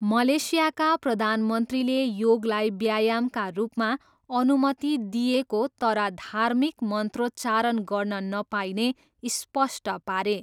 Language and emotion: Nepali, neutral